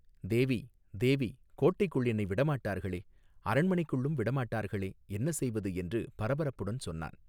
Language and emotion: Tamil, neutral